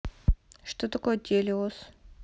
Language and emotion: Russian, neutral